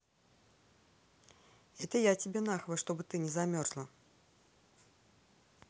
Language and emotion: Russian, angry